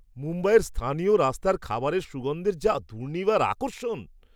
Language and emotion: Bengali, surprised